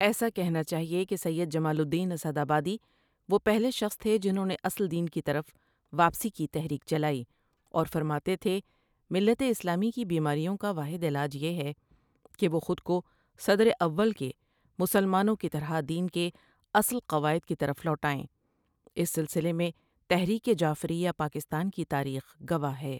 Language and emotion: Urdu, neutral